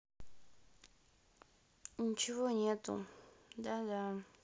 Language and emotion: Russian, sad